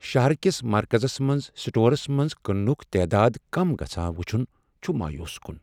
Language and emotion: Kashmiri, sad